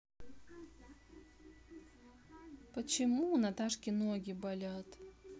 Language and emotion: Russian, neutral